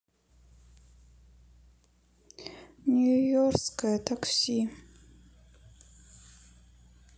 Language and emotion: Russian, sad